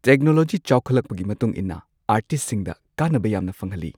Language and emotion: Manipuri, neutral